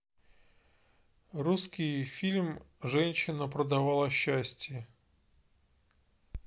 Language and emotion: Russian, neutral